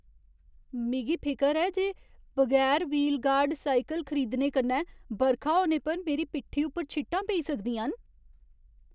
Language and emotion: Dogri, fearful